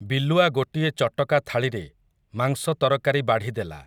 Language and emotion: Odia, neutral